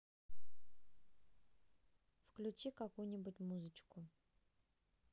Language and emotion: Russian, neutral